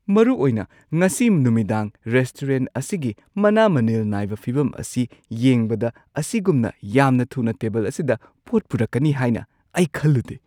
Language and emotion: Manipuri, surprised